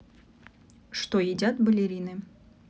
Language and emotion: Russian, neutral